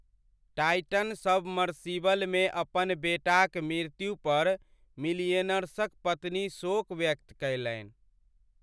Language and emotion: Maithili, sad